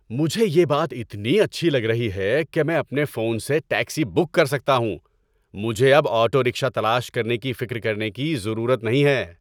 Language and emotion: Urdu, happy